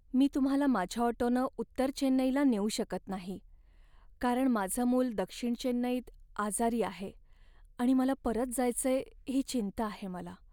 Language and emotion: Marathi, sad